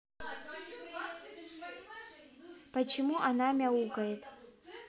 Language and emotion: Russian, neutral